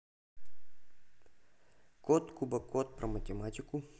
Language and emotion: Russian, neutral